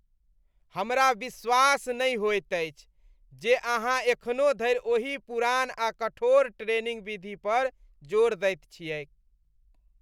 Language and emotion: Maithili, disgusted